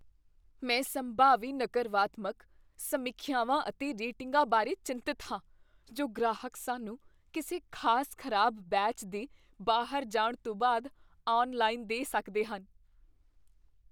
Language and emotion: Punjabi, fearful